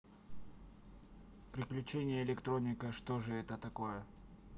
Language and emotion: Russian, neutral